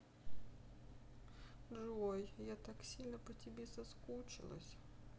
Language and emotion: Russian, sad